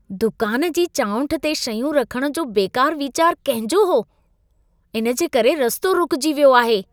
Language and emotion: Sindhi, disgusted